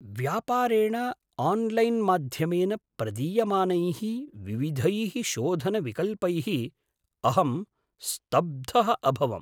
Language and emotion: Sanskrit, surprised